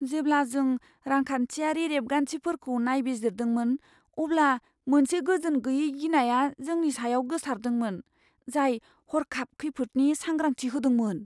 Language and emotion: Bodo, fearful